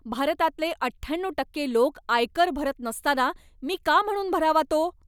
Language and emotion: Marathi, angry